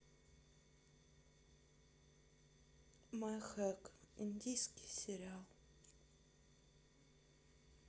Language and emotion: Russian, sad